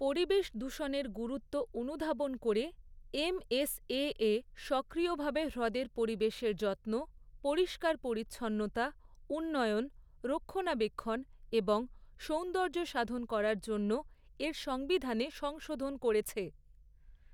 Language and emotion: Bengali, neutral